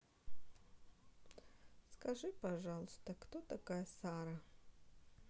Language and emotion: Russian, neutral